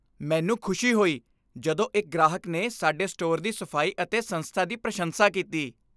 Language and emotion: Punjabi, happy